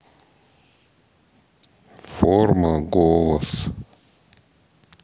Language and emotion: Russian, neutral